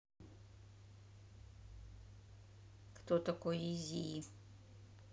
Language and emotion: Russian, neutral